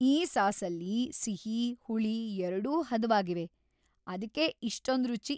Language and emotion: Kannada, happy